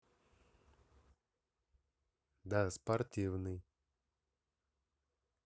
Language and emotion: Russian, neutral